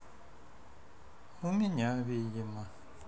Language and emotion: Russian, sad